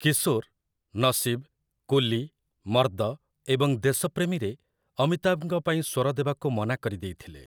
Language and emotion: Odia, neutral